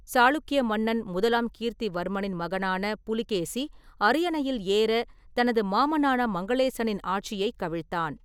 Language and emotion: Tamil, neutral